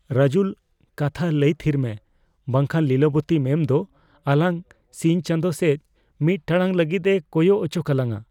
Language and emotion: Santali, fearful